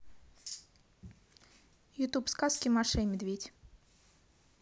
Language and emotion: Russian, neutral